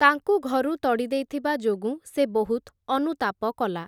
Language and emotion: Odia, neutral